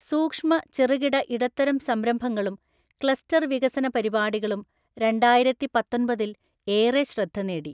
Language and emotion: Malayalam, neutral